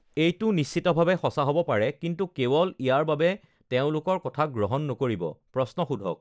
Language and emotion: Assamese, neutral